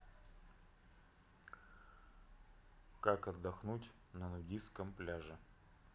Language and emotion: Russian, neutral